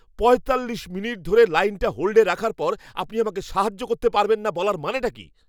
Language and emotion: Bengali, angry